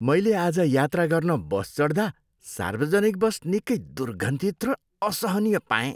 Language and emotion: Nepali, disgusted